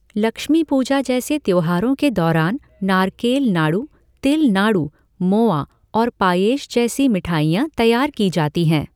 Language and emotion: Hindi, neutral